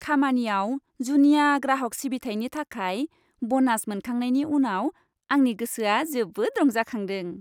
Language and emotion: Bodo, happy